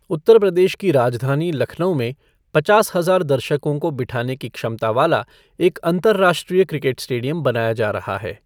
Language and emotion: Hindi, neutral